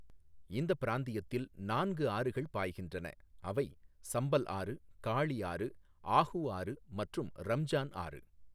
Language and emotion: Tamil, neutral